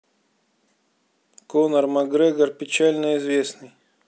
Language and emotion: Russian, neutral